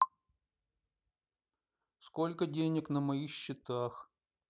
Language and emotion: Russian, sad